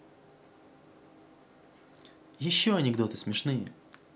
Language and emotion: Russian, neutral